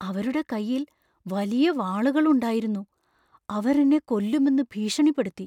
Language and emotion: Malayalam, fearful